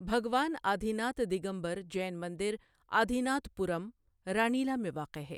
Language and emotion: Urdu, neutral